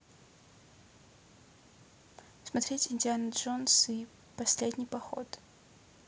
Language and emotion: Russian, neutral